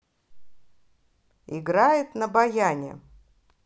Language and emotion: Russian, positive